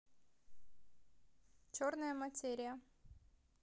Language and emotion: Russian, neutral